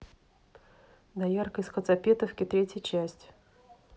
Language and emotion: Russian, neutral